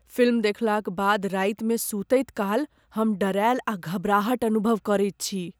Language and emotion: Maithili, fearful